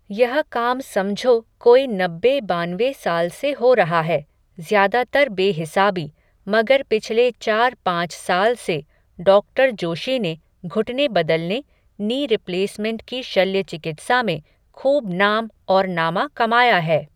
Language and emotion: Hindi, neutral